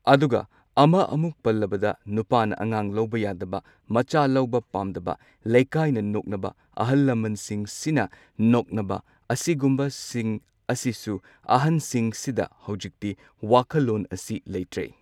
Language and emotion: Manipuri, neutral